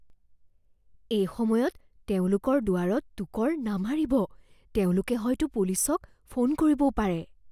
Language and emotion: Assamese, fearful